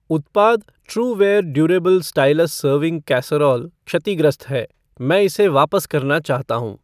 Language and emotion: Hindi, neutral